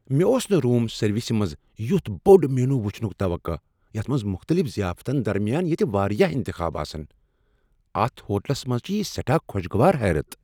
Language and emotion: Kashmiri, surprised